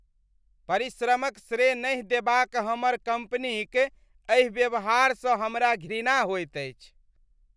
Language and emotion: Maithili, disgusted